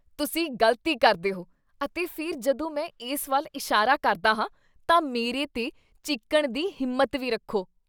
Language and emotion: Punjabi, disgusted